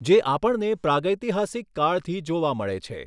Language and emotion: Gujarati, neutral